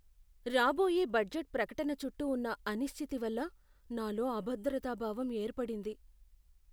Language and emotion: Telugu, fearful